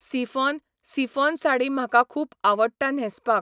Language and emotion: Goan Konkani, neutral